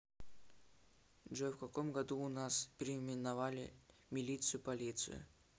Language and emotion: Russian, neutral